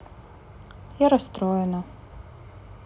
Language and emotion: Russian, sad